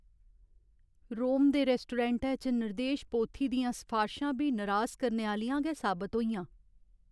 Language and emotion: Dogri, sad